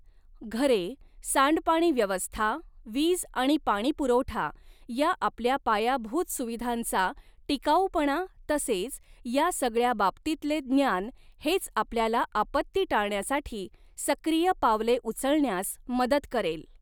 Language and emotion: Marathi, neutral